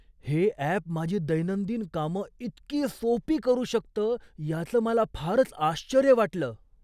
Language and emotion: Marathi, surprised